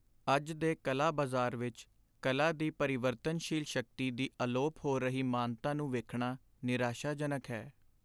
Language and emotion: Punjabi, sad